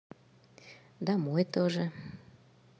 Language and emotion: Russian, positive